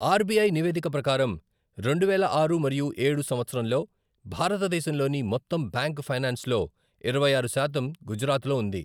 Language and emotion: Telugu, neutral